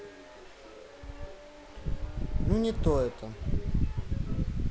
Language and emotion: Russian, sad